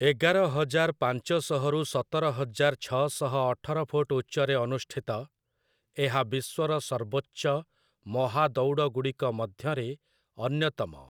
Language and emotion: Odia, neutral